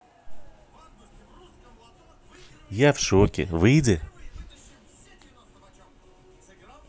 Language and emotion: Russian, neutral